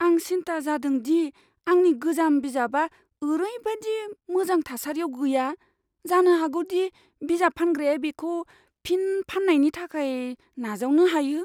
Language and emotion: Bodo, fearful